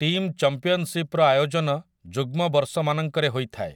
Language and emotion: Odia, neutral